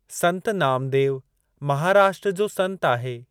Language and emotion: Sindhi, neutral